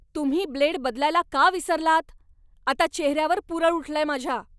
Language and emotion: Marathi, angry